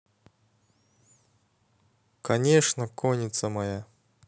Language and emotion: Russian, neutral